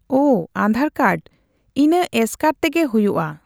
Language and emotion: Santali, neutral